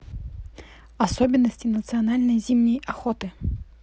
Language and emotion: Russian, neutral